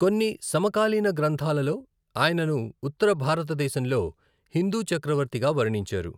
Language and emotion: Telugu, neutral